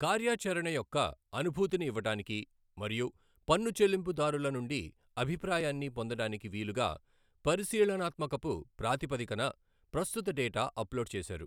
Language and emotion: Telugu, neutral